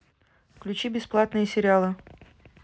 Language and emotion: Russian, neutral